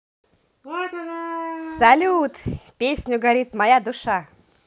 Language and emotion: Russian, positive